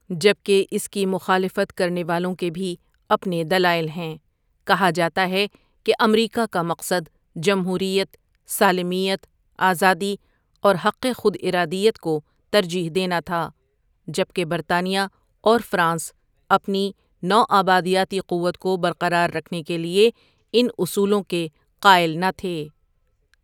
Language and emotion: Urdu, neutral